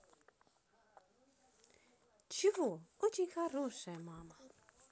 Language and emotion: Russian, positive